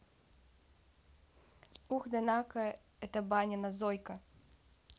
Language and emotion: Russian, neutral